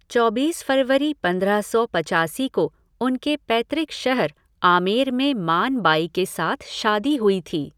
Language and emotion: Hindi, neutral